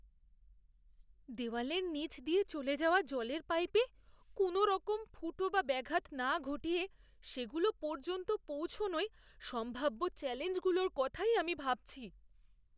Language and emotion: Bengali, fearful